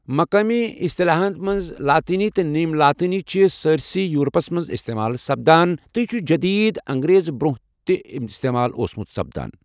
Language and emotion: Kashmiri, neutral